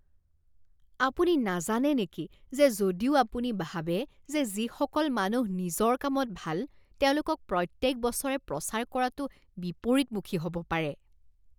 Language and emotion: Assamese, disgusted